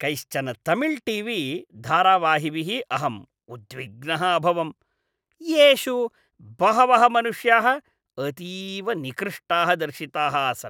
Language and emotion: Sanskrit, disgusted